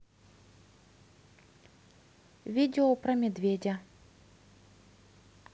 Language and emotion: Russian, neutral